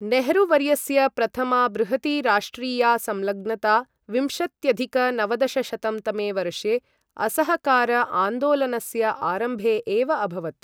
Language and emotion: Sanskrit, neutral